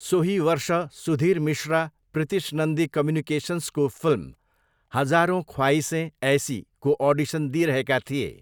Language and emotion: Nepali, neutral